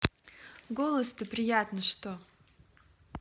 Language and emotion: Russian, positive